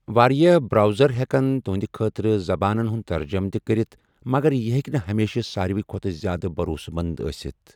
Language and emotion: Kashmiri, neutral